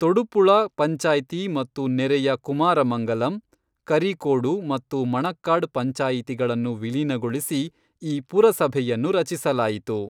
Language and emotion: Kannada, neutral